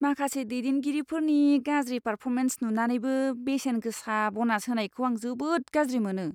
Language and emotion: Bodo, disgusted